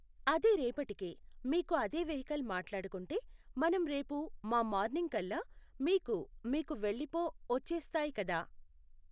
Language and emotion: Telugu, neutral